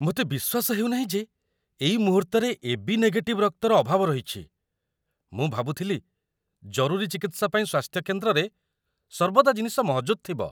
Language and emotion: Odia, surprised